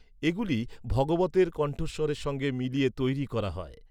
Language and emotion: Bengali, neutral